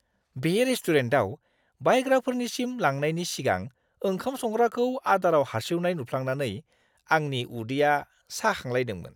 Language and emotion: Bodo, disgusted